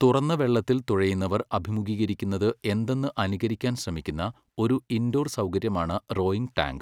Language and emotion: Malayalam, neutral